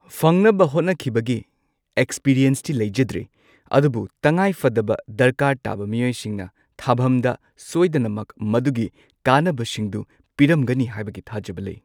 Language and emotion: Manipuri, neutral